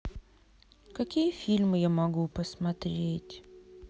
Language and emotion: Russian, sad